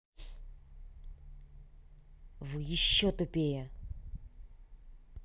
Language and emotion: Russian, angry